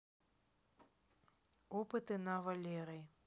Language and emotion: Russian, neutral